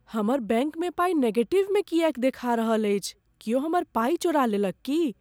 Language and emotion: Maithili, fearful